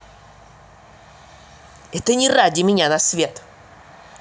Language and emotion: Russian, angry